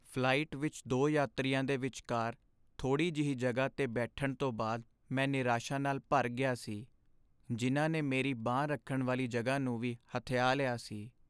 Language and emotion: Punjabi, sad